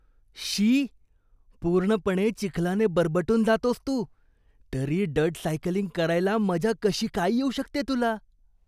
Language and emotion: Marathi, disgusted